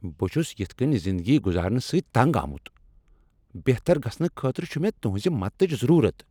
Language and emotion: Kashmiri, angry